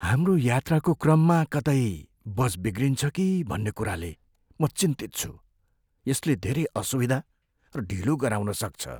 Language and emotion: Nepali, fearful